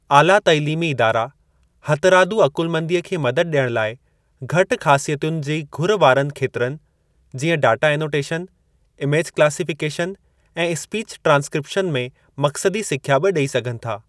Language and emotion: Sindhi, neutral